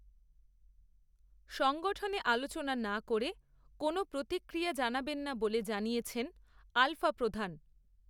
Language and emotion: Bengali, neutral